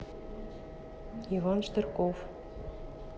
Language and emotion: Russian, neutral